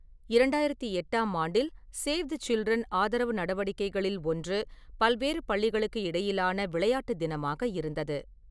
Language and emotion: Tamil, neutral